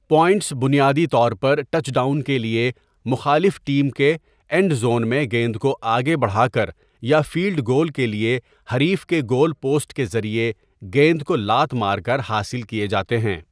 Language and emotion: Urdu, neutral